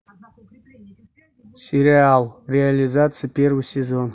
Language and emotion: Russian, neutral